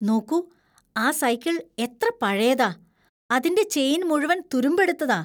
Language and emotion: Malayalam, disgusted